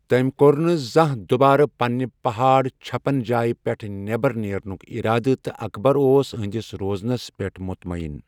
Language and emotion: Kashmiri, neutral